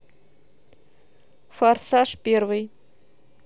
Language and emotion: Russian, neutral